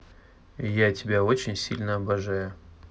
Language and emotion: Russian, neutral